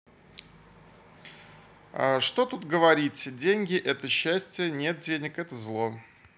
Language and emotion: Russian, neutral